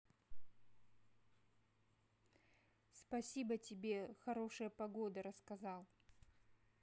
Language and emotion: Russian, neutral